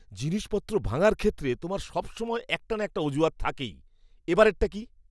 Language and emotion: Bengali, disgusted